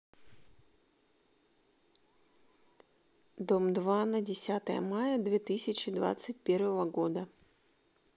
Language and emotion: Russian, neutral